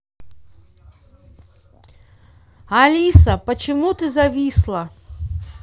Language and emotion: Russian, neutral